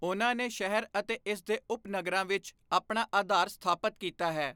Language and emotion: Punjabi, neutral